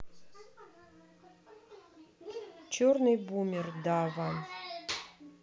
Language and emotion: Russian, neutral